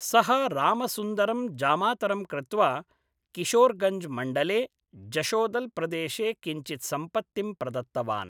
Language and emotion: Sanskrit, neutral